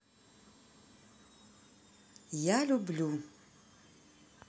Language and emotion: Russian, neutral